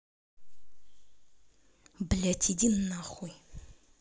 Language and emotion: Russian, angry